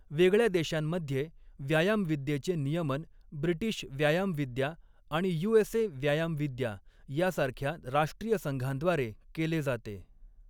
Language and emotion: Marathi, neutral